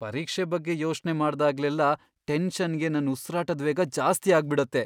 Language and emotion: Kannada, fearful